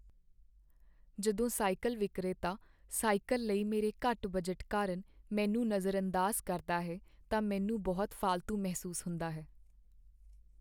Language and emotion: Punjabi, sad